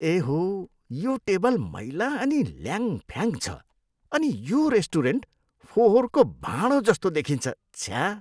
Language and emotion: Nepali, disgusted